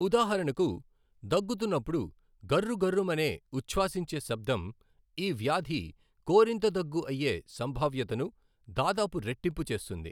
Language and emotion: Telugu, neutral